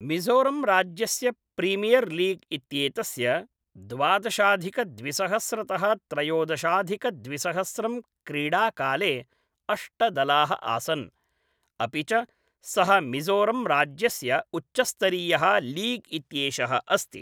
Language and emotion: Sanskrit, neutral